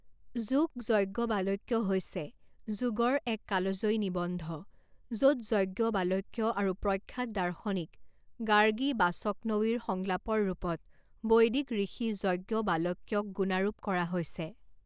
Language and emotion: Assamese, neutral